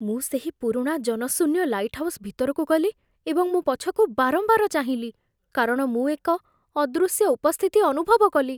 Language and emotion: Odia, fearful